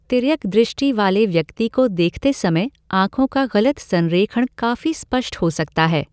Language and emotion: Hindi, neutral